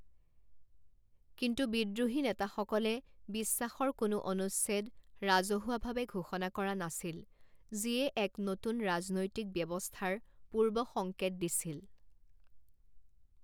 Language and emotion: Assamese, neutral